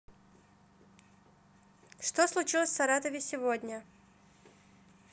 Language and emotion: Russian, neutral